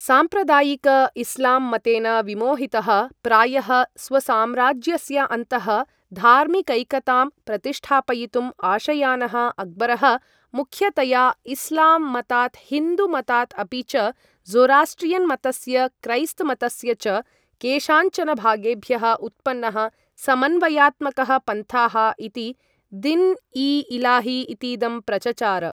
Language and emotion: Sanskrit, neutral